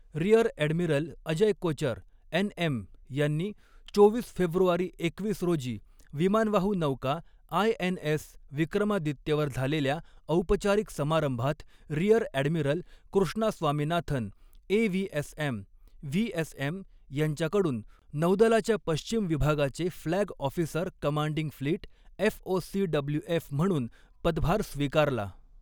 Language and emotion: Marathi, neutral